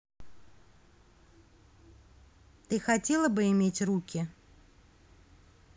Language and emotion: Russian, neutral